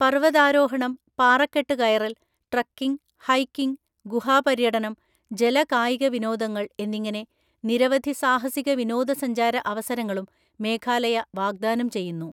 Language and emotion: Malayalam, neutral